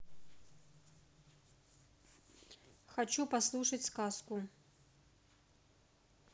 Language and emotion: Russian, neutral